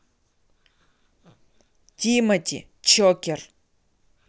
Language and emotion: Russian, neutral